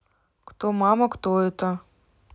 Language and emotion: Russian, neutral